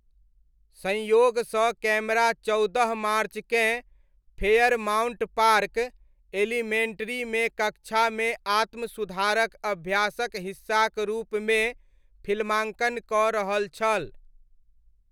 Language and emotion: Maithili, neutral